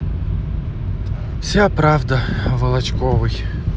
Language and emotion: Russian, sad